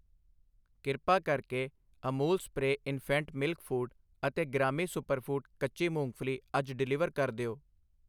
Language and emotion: Punjabi, neutral